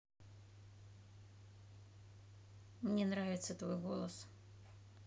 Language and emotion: Russian, neutral